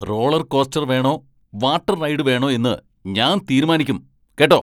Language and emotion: Malayalam, angry